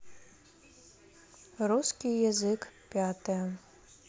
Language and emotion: Russian, neutral